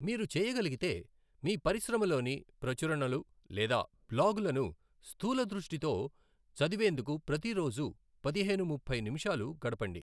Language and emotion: Telugu, neutral